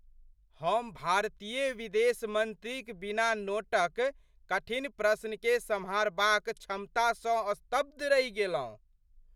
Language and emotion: Maithili, surprised